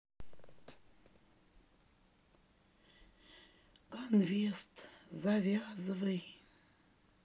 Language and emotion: Russian, sad